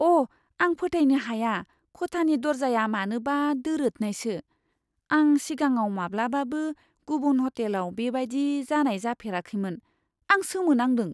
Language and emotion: Bodo, surprised